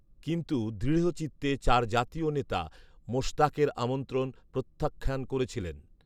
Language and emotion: Bengali, neutral